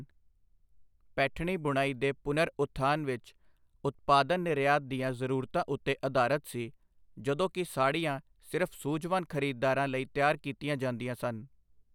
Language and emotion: Punjabi, neutral